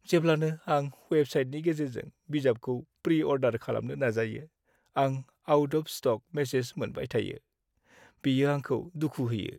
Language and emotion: Bodo, sad